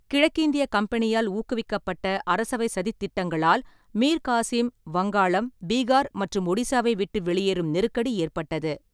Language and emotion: Tamil, neutral